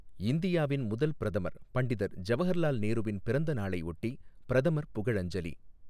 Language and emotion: Tamil, neutral